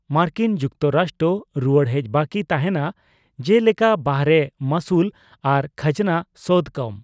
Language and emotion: Santali, neutral